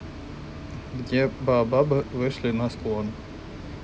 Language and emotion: Russian, neutral